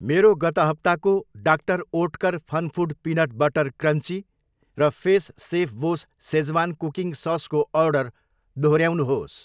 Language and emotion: Nepali, neutral